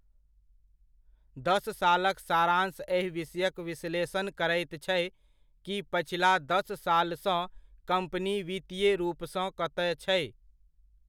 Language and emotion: Maithili, neutral